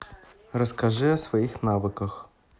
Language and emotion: Russian, neutral